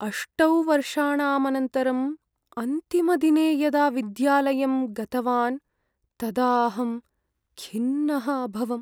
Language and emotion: Sanskrit, sad